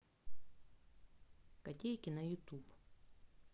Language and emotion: Russian, neutral